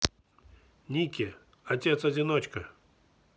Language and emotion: Russian, neutral